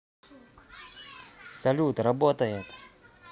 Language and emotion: Russian, positive